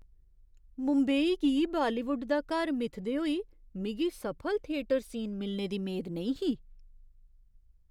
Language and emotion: Dogri, surprised